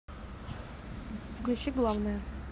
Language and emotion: Russian, neutral